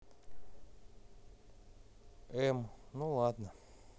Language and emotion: Russian, neutral